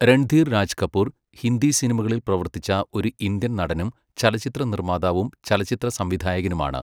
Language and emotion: Malayalam, neutral